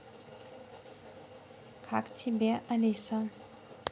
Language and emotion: Russian, neutral